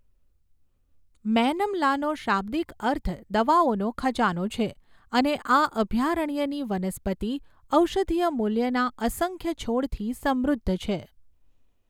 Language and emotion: Gujarati, neutral